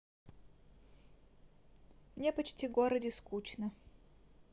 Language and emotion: Russian, neutral